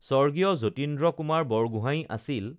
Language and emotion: Assamese, neutral